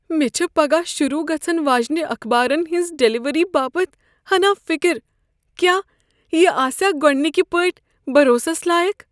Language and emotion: Kashmiri, fearful